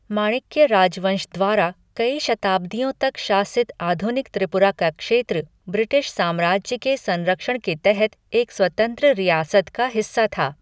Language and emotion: Hindi, neutral